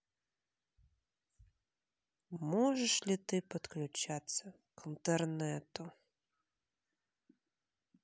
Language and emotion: Russian, neutral